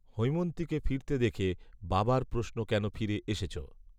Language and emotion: Bengali, neutral